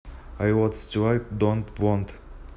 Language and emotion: Russian, neutral